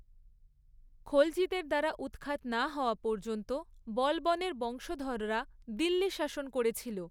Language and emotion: Bengali, neutral